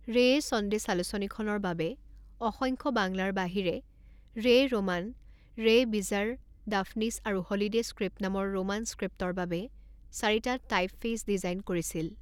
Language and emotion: Assamese, neutral